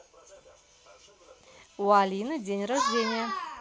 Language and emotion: Russian, positive